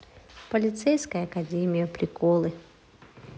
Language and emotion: Russian, neutral